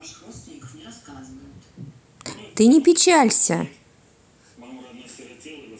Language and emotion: Russian, positive